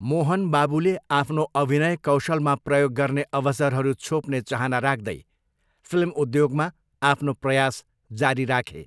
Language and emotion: Nepali, neutral